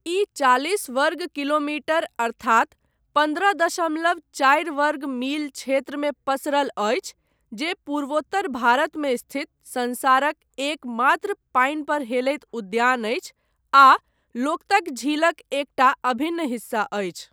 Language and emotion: Maithili, neutral